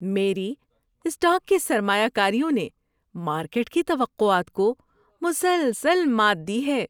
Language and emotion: Urdu, happy